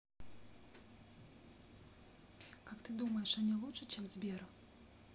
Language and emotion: Russian, neutral